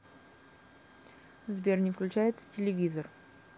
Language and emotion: Russian, neutral